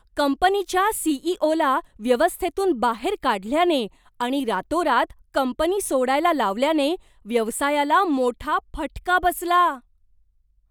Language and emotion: Marathi, surprised